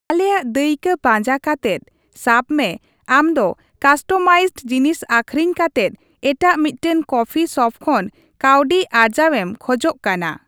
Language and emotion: Santali, neutral